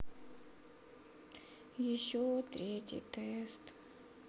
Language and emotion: Russian, sad